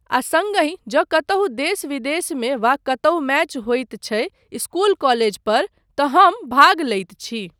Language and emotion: Maithili, neutral